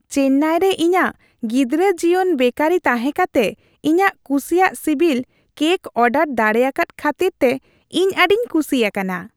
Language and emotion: Santali, happy